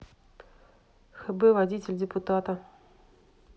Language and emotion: Russian, neutral